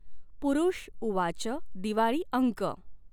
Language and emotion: Marathi, neutral